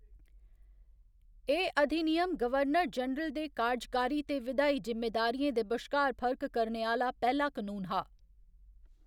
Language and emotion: Dogri, neutral